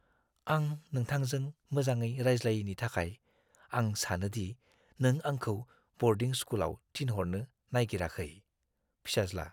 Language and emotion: Bodo, fearful